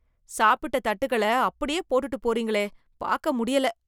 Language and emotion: Tamil, disgusted